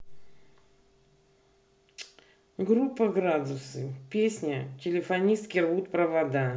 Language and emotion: Russian, neutral